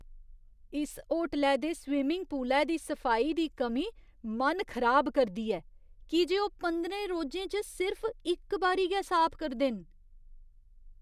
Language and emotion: Dogri, disgusted